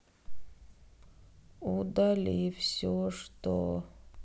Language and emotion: Russian, sad